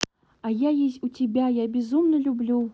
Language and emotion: Russian, neutral